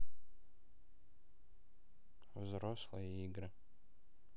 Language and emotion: Russian, neutral